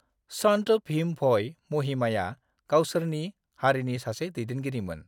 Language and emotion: Bodo, neutral